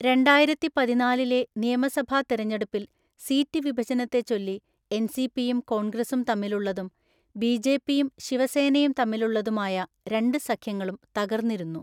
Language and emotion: Malayalam, neutral